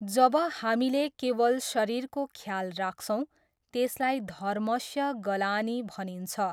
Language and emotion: Nepali, neutral